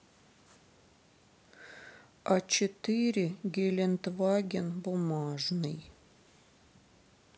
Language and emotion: Russian, sad